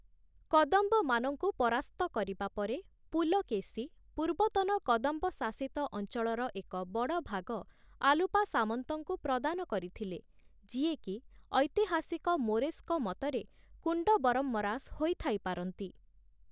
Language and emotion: Odia, neutral